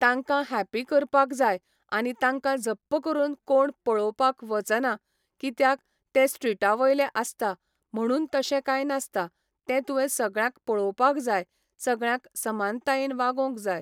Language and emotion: Goan Konkani, neutral